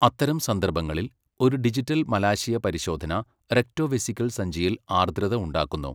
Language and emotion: Malayalam, neutral